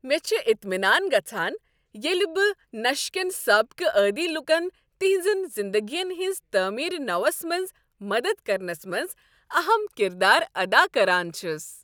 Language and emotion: Kashmiri, happy